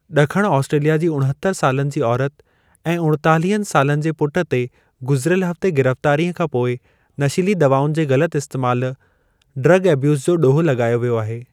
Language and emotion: Sindhi, neutral